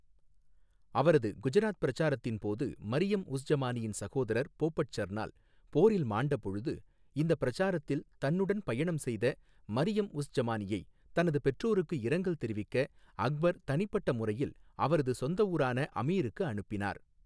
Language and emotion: Tamil, neutral